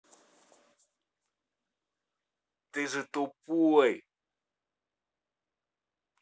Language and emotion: Russian, angry